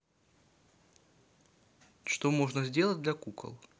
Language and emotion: Russian, neutral